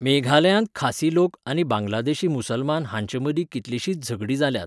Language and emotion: Goan Konkani, neutral